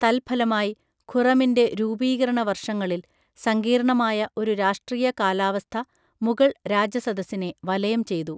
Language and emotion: Malayalam, neutral